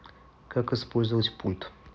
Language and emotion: Russian, neutral